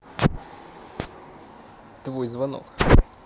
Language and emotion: Russian, neutral